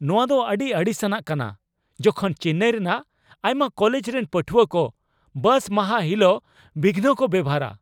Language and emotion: Santali, angry